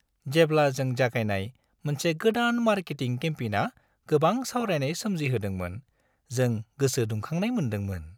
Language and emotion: Bodo, happy